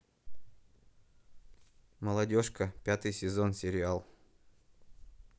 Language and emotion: Russian, neutral